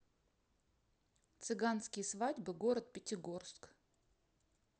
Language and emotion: Russian, neutral